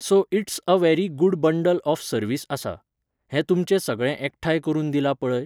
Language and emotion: Goan Konkani, neutral